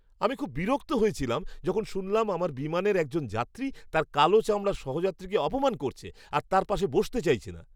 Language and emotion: Bengali, disgusted